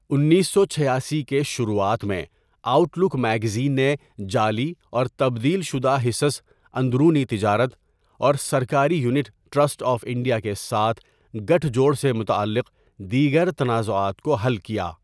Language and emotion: Urdu, neutral